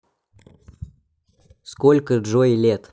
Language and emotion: Russian, neutral